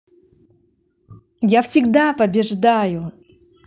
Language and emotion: Russian, positive